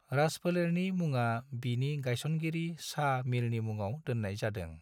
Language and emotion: Bodo, neutral